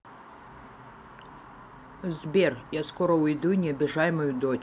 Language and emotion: Russian, neutral